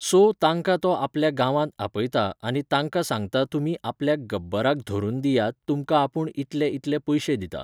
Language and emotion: Goan Konkani, neutral